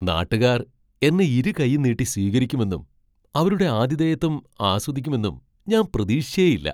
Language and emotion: Malayalam, surprised